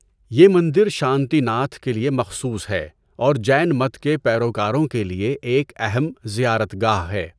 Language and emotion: Urdu, neutral